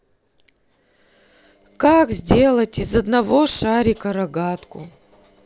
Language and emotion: Russian, sad